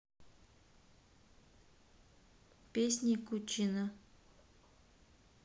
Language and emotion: Russian, neutral